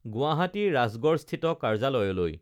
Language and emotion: Assamese, neutral